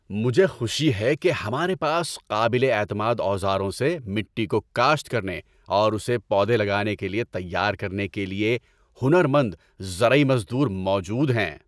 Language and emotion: Urdu, happy